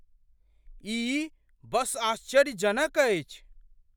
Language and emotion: Maithili, surprised